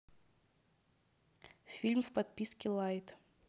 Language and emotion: Russian, neutral